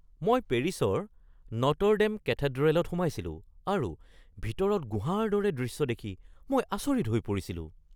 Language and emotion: Assamese, surprised